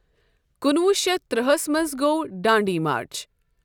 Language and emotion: Kashmiri, neutral